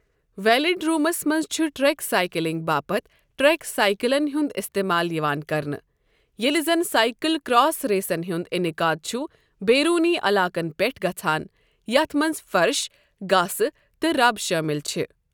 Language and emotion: Kashmiri, neutral